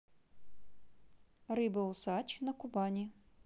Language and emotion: Russian, neutral